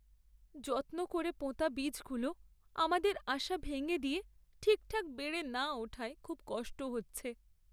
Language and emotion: Bengali, sad